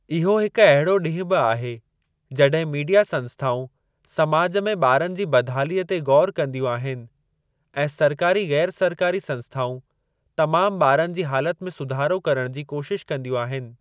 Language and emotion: Sindhi, neutral